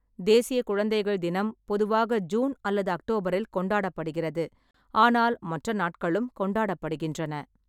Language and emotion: Tamil, neutral